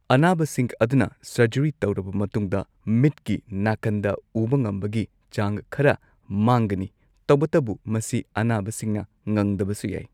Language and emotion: Manipuri, neutral